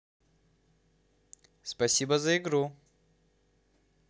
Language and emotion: Russian, positive